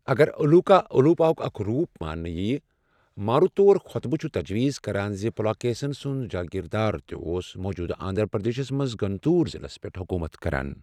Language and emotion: Kashmiri, neutral